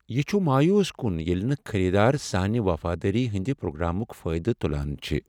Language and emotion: Kashmiri, sad